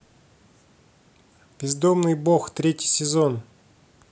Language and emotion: Russian, neutral